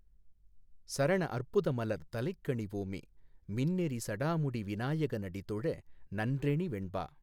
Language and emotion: Tamil, neutral